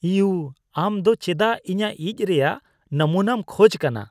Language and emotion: Santali, disgusted